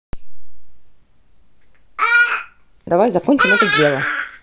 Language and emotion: Russian, neutral